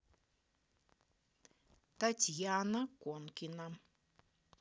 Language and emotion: Russian, neutral